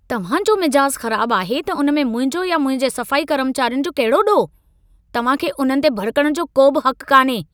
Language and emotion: Sindhi, angry